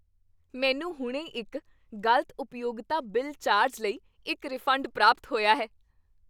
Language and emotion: Punjabi, happy